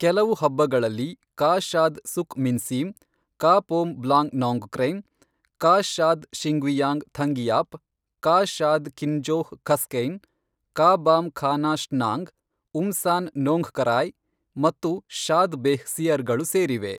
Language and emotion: Kannada, neutral